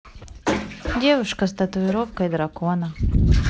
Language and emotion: Russian, neutral